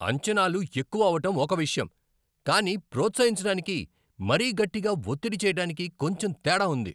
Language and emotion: Telugu, angry